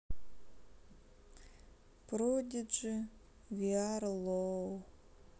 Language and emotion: Russian, sad